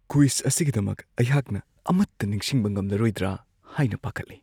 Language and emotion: Manipuri, fearful